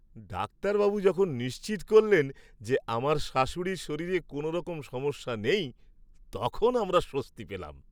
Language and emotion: Bengali, happy